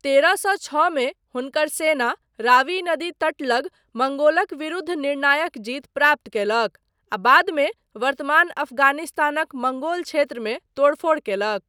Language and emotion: Maithili, neutral